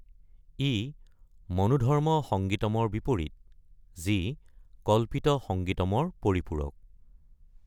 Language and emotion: Assamese, neutral